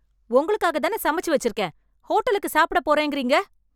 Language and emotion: Tamil, angry